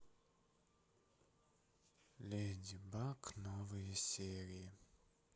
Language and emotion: Russian, sad